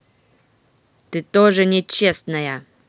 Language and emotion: Russian, angry